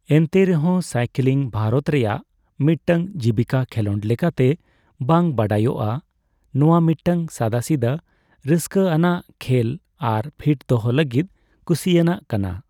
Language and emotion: Santali, neutral